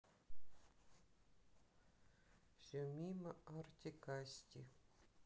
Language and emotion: Russian, sad